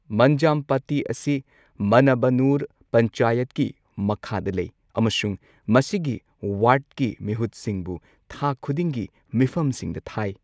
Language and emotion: Manipuri, neutral